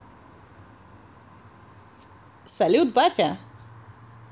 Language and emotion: Russian, positive